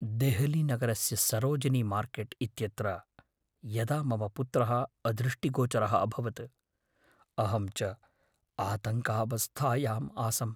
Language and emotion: Sanskrit, fearful